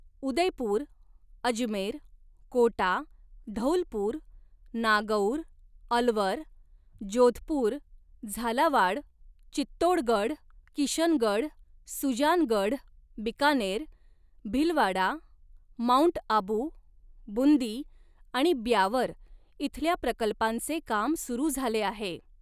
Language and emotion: Marathi, neutral